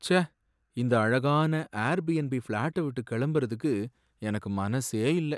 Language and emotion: Tamil, sad